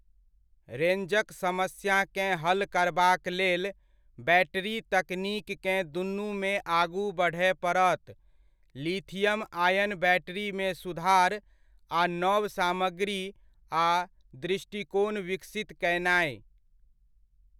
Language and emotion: Maithili, neutral